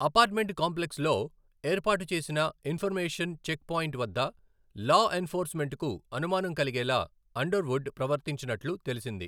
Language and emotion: Telugu, neutral